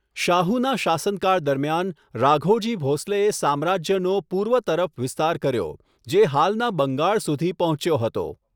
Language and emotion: Gujarati, neutral